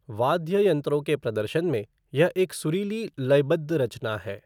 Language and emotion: Hindi, neutral